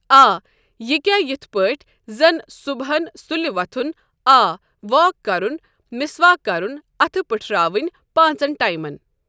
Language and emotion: Kashmiri, neutral